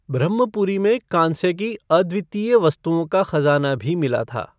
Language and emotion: Hindi, neutral